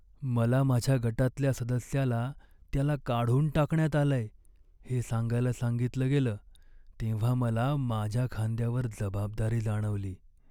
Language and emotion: Marathi, sad